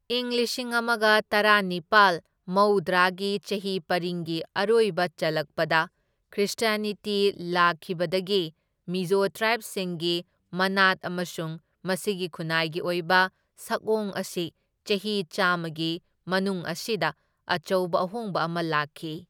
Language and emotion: Manipuri, neutral